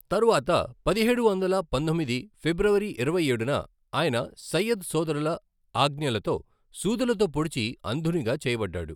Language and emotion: Telugu, neutral